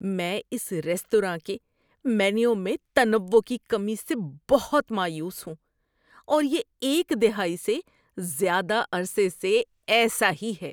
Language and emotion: Urdu, disgusted